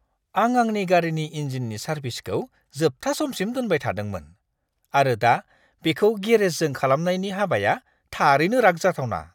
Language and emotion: Bodo, disgusted